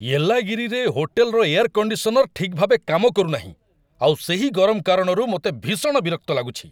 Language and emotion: Odia, angry